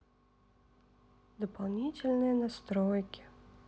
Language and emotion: Russian, sad